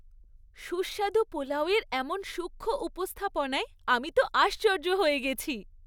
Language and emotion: Bengali, happy